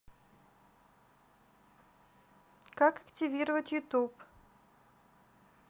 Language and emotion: Russian, neutral